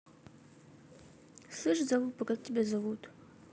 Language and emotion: Russian, neutral